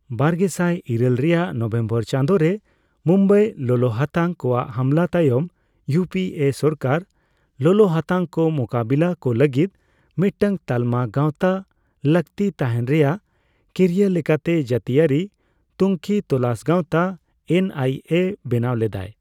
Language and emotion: Santali, neutral